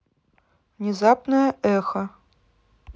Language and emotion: Russian, neutral